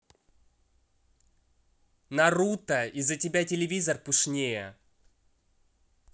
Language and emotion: Russian, angry